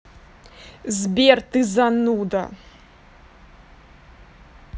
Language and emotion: Russian, angry